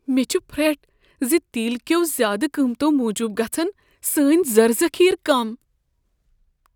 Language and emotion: Kashmiri, fearful